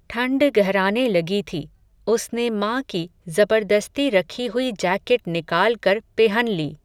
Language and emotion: Hindi, neutral